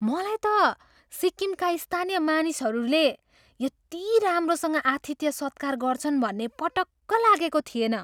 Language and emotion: Nepali, surprised